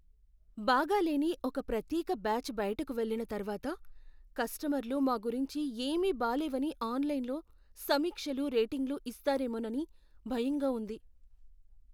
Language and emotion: Telugu, fearful